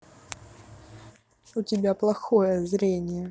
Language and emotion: Russian, angry